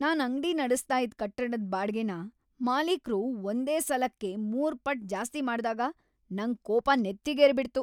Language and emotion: Kannada, angry